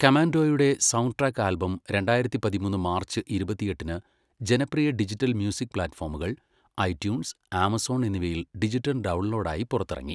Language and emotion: Malayalam, neutral